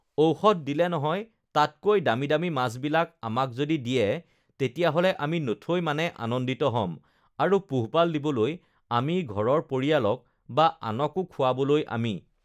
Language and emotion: Assamese, neutral